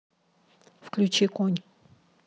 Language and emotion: Russian, neutral